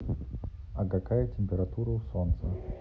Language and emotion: Russian, neutral